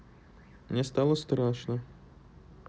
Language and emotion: Russian, neutral